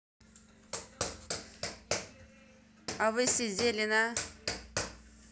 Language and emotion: Russian, neutral